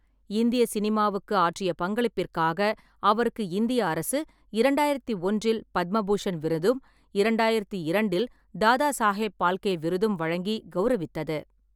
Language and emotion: Tamil, neutral